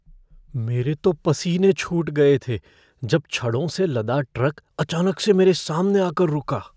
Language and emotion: Hindi, fearful